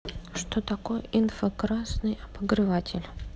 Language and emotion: Russian, neutral